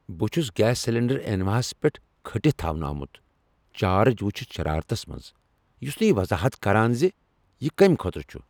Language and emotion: Kashmiri, angry